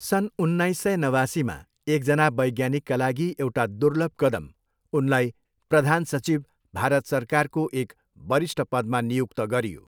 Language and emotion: Nepali, neutral